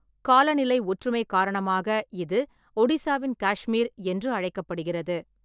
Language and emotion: Tamil, neutral